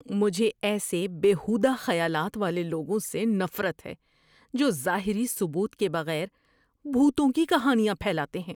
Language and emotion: Urdu, disgusted